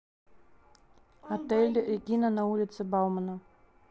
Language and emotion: Russian, neutral